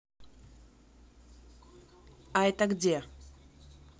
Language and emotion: Russian, neutral